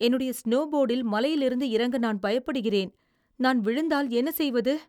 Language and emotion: Tamil, fearful